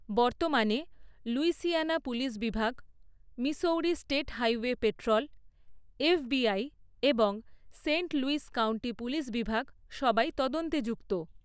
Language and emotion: Bengali, neutral